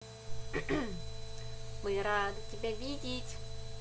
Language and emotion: Russian, positive